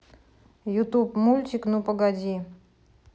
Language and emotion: Russian, neutral